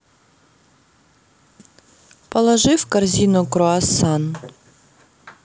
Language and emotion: Russian, neutral